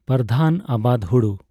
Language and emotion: Santali, neutral